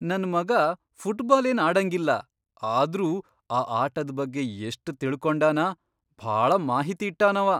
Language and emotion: Kannada, surprised